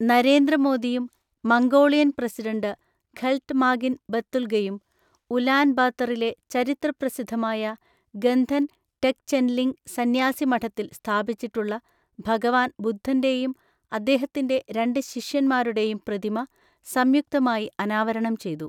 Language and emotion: Malayalam, neutral